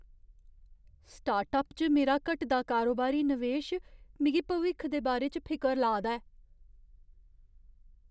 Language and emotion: Dogri, fearful